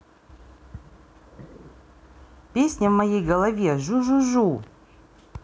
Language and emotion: Russian, neutral